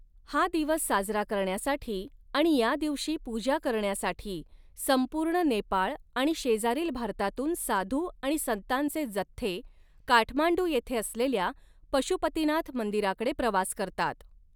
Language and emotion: Marathi, neutral